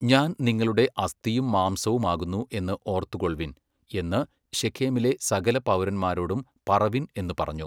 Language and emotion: Malayalam, neutral